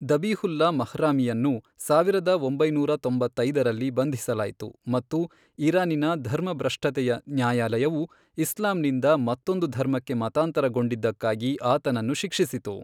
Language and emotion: Kannada, neutral